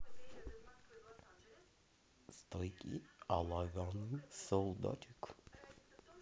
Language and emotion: Russian, neutral